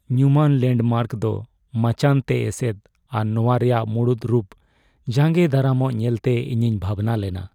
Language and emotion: Santali, sad